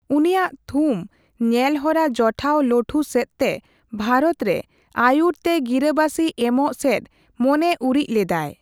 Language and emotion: Santali, neutral